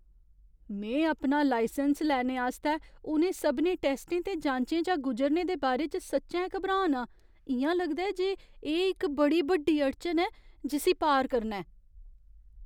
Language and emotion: Dogri, fearful